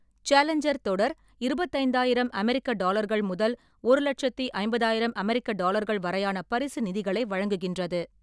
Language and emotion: Tamil, neutral